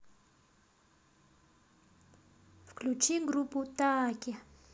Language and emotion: Russian, neutral